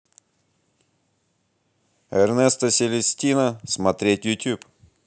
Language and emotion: Russian, positive